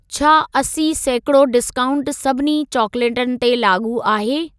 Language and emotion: Sindhi, neutral